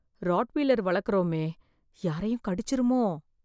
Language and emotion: Tamil, fearful